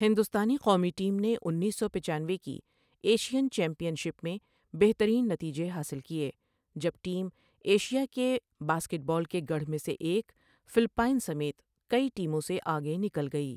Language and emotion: Urdu, neutral